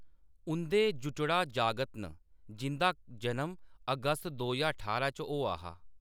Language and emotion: Dogri, neutral